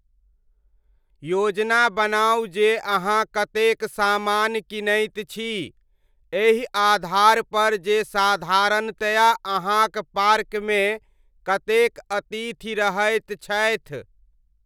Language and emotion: Maithili, neutral